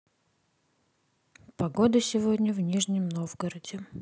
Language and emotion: Russian, neutral